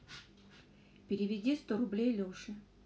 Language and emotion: Russian, neutral